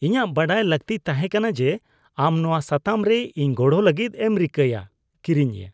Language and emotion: Santali, disgusted